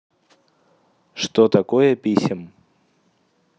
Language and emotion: Russian, neutral